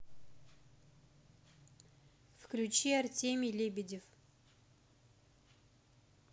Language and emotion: Russian, neutral